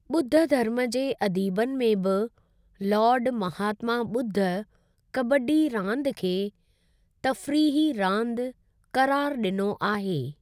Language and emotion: Sindhi, neutral